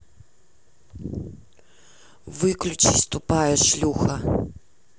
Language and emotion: Russian, angry